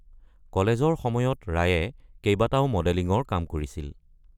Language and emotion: Assamese, neutral